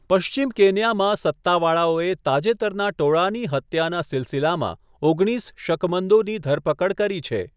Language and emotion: Gujarati, neutral